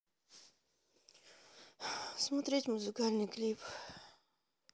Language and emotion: Russian, sad